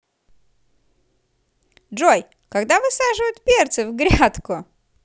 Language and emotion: Russian, positive